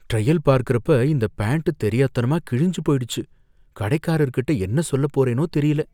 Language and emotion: Tamil, fearful